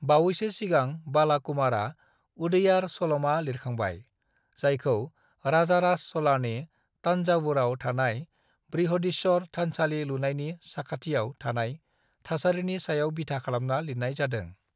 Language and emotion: Bodo, neutral